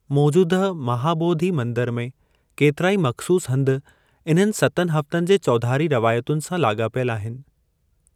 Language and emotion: Sindhi, neutral